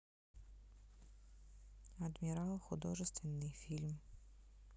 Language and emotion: Russian, neutral